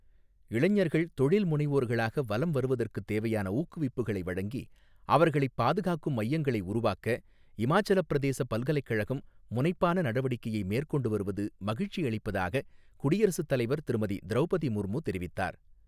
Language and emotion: Tamil, neutral